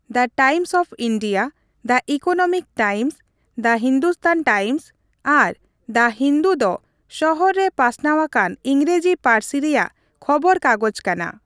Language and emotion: Santali, neutral